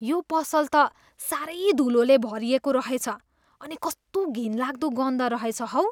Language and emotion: Nepali, disgusted